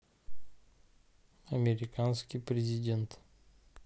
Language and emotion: Russian, neutral